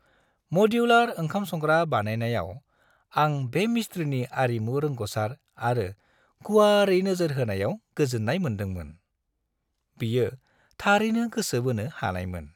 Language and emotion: Bodo, happy